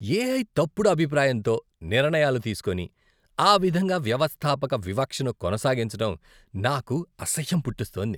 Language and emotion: Telugu, disgusted